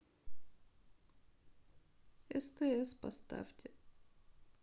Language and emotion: Russian, sad